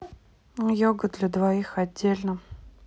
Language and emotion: Russian, neutral